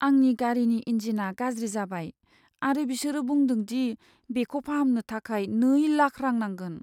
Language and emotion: Bodo, sad